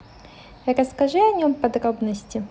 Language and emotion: Russian, neutral